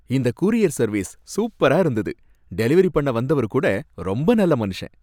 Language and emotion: Tamil, happy